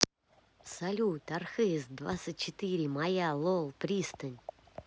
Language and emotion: Russian, positive